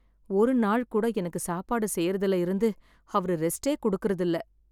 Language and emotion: Tamil, sad